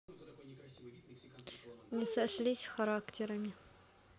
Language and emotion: Russian, sad